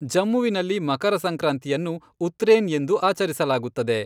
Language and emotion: Kannada, neutral